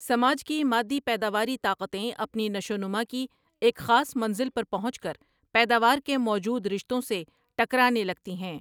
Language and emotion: Urdu, neutral